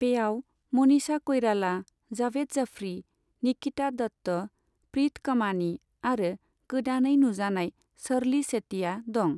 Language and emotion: Bodo, neutral